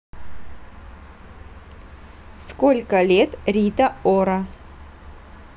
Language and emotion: Russian, neutral